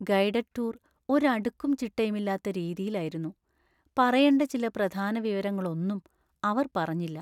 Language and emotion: Malayalam, sad